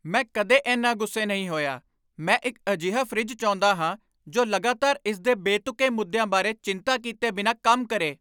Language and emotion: Punjabi, angry